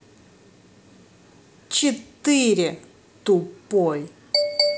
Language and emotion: Russian, angry